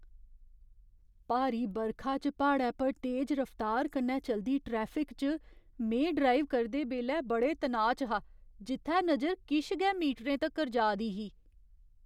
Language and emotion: Dogri, fearful